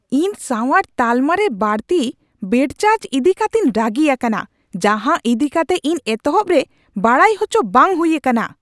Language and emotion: Santali, angry